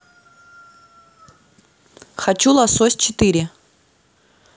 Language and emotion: Russian, neutral